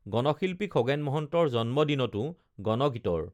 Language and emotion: Assamese, neutral